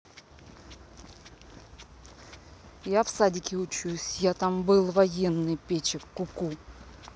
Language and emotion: Russian, neutral